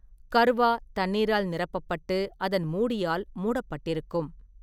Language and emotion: Tamil, neutral